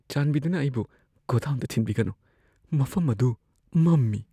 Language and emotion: Manipuri, fearful